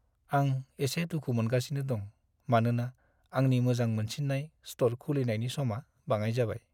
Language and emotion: Bodo, sad